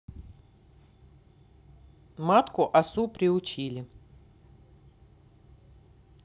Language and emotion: Russian, neutral